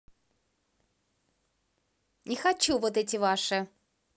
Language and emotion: Russian, angry